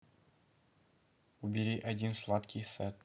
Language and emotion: Russian, neutral